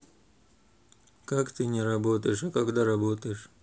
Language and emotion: Russian, neutral